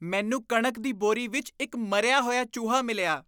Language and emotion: Punjabi, disgusted